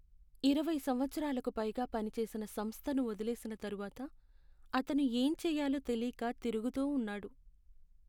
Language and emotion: Telugu, sad